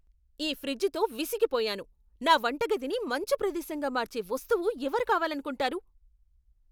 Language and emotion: Telugu, angry